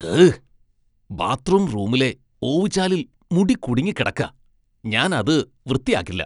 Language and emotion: Malayalam, disgusted